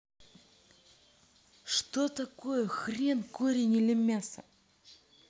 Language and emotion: Russian, angry